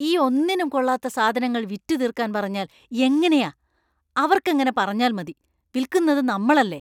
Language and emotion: Malayalam, disgusted